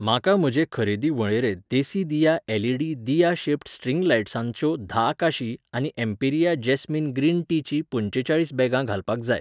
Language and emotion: Goan Konkani, neutral